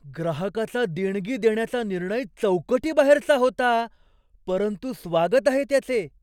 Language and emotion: Marathi, surprised